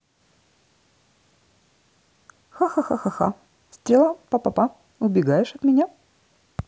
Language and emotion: Russian, positive